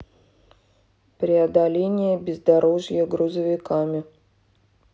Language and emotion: Russian, neutral